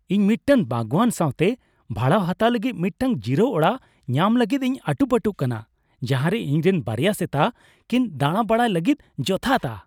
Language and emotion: Santali, happy